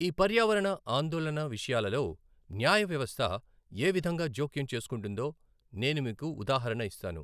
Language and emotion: Telugu, neutral